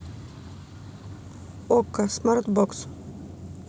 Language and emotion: Russian, neutral